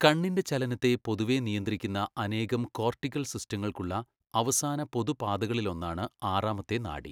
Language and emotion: Malayalam, neutral